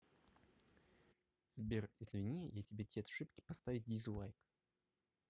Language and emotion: Russian, neutral